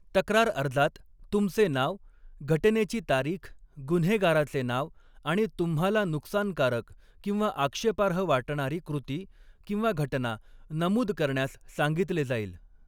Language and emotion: Marathi, neutral